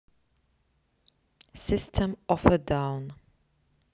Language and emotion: Russian, neutral